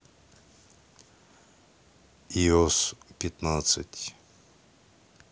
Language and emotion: Russian, neutral